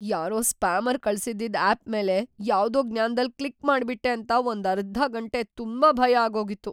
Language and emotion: Kannada, fearful